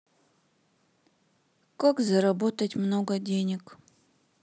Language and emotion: Russian, sad